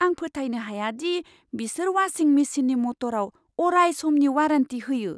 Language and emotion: Bodo, surprised